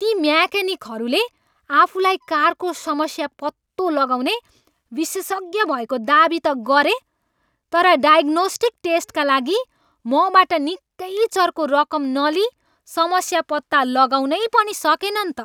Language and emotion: Nepali, angry